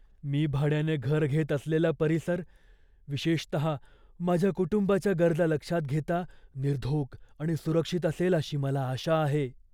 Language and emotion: Marathi, fearful